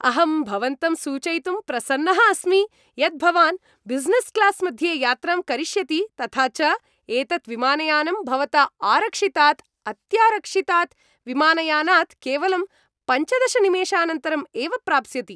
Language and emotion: Sanskrit, happy